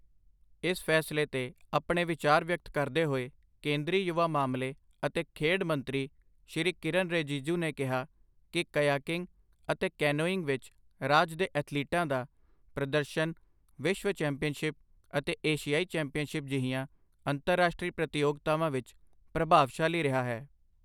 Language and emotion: Punjabi, neutral